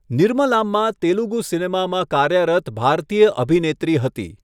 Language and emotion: Gujarati, neutral